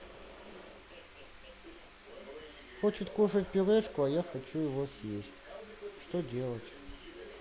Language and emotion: Russian, sad